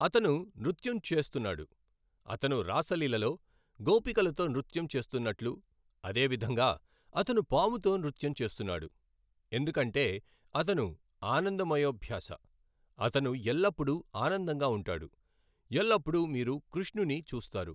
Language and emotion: Telugu, neutral